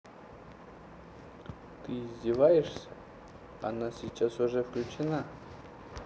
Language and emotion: Russian, neutral